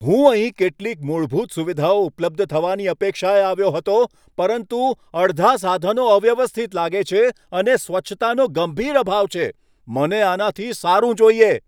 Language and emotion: Gujarati, angry